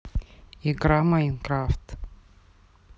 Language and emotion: Russian, neutral